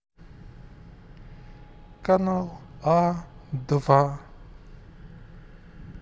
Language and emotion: Russian, neutral